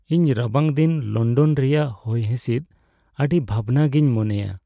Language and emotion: Santali, sad